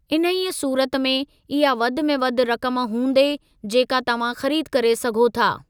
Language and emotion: Sindhi, neutral